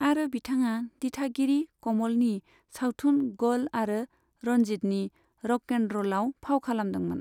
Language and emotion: Bodo, neutral